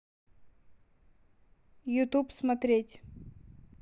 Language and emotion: Russian, neutral